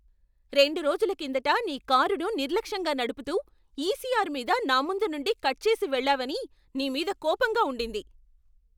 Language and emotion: Telugu, angry